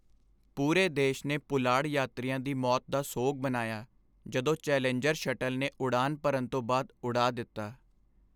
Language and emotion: Punjabi, sad